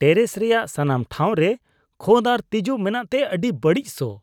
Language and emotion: Santali, disgusted